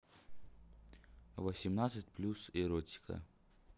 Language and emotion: Russian, neutral